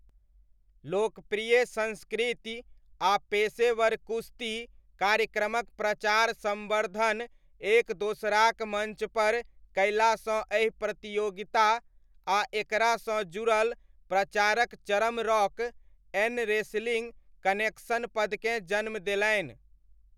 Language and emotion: Maithili, neutral